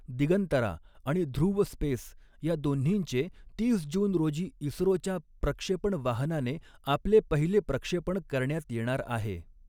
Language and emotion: Marathi, neutral